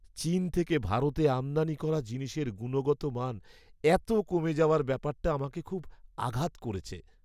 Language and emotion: Bengali, sad